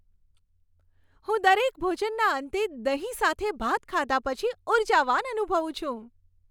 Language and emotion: Gujarati, happy